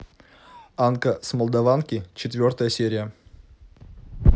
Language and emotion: Russian, neutral